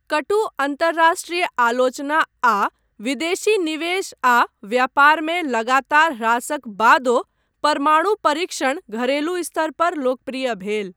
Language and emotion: Maithili, neutral